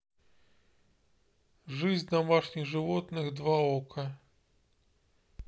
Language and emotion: Russian, neutral